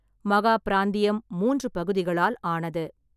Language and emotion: Tamil, neutral